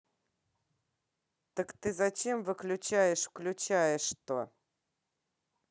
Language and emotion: Russian, angry